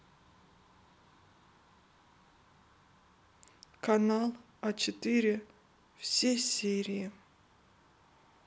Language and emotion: Russian, sad